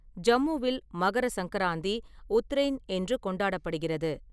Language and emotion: Tamil, neutral